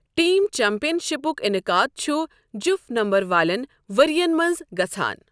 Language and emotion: Kashmiri, neutral